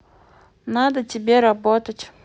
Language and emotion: Russian, neutral